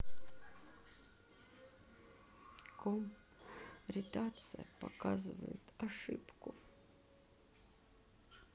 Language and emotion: Russian, sad